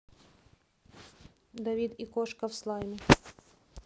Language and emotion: Russian, neutral